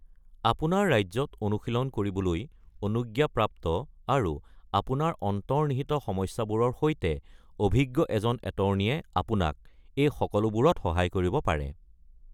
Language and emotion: Assamese, neutral